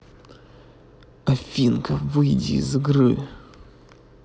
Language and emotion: Russian, angry